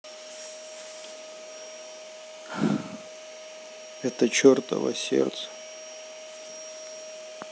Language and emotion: Russian, sad